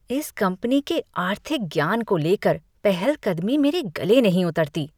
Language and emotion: Hindi, disgusted